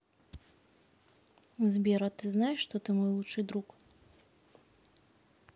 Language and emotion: Russian, neutral